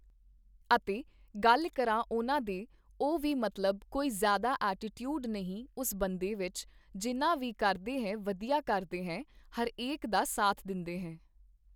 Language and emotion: Punjabi, neutral